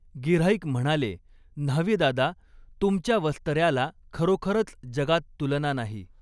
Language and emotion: Marathi, neutral